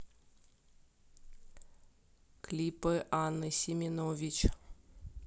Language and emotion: Russian, neutral